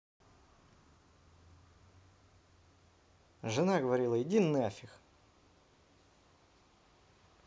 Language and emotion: Russian, neutral